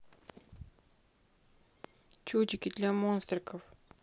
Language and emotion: Russian, neutral